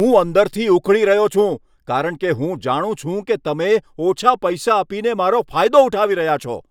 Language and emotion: Gujarati, angry